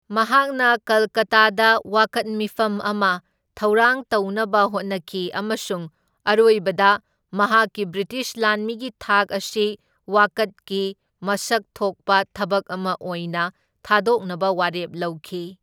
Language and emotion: Manipuri, neutral